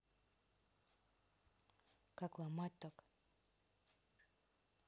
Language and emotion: Russian, neutral